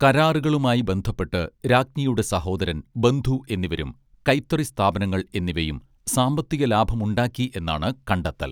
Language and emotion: Malayalam, neutral